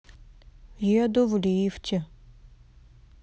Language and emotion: Russian, sad